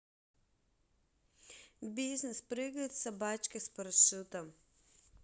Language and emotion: Russian, neutral